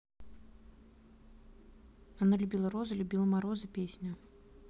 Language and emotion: Russian, neutral